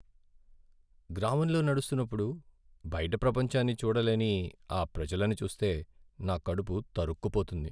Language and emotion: Telugu, sad